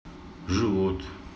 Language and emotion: Russian, neutral